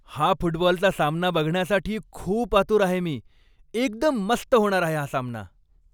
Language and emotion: Marathi, happy